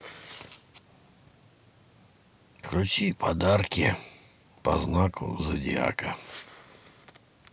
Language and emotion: Russian, neutral